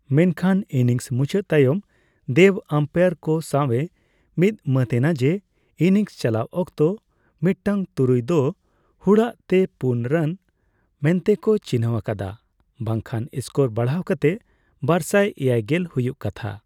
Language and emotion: Santali, neutral